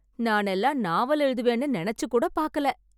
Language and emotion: Tamil, surprised